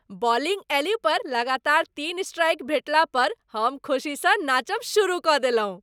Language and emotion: Maithili, happy